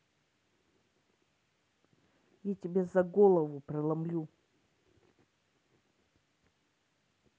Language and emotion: Russian, angry